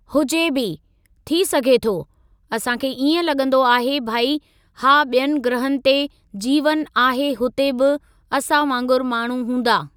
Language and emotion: Sindhi, neutral